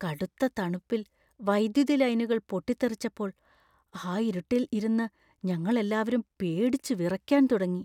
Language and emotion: Malayalam, fearful